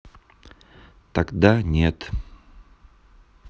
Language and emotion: Russian, neutral